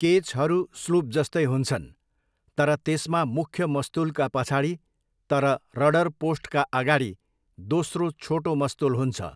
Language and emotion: Nepali, neutral